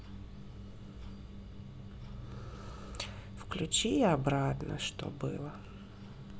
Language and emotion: Russian, neutral